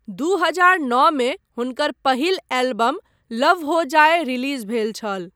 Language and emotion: Maithili, neutral